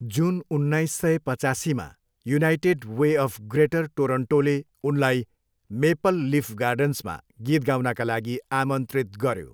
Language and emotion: Nepali, neutral